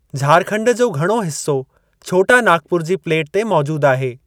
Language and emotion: Sindhi, neutral